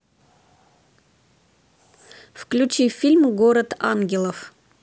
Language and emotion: Russian, neutral